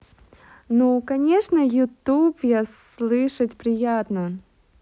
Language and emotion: Russian, positive